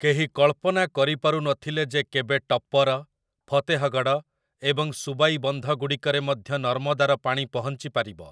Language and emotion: Odia, neutral